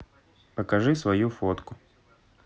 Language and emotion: Russian, neutral